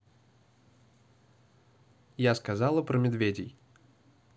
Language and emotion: Russian, angry